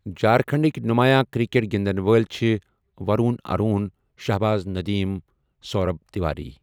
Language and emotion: Kashmiri, neutral